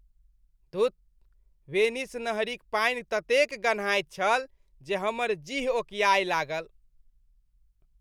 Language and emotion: Maithili, disgusted